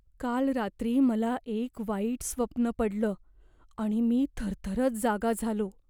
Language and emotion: Marathi, fearful